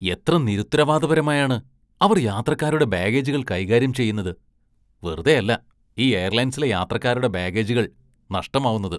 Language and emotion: Malayalam, disgusted